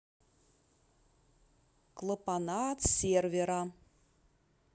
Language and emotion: Russian, neutral